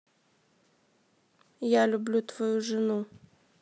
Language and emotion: Russian, neutral